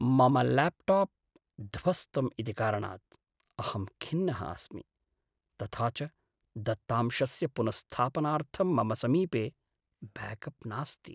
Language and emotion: Sanskrit, sad